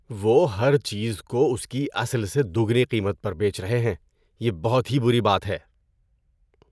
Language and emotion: Urdu, disgusted